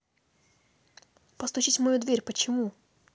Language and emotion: Russian, neutral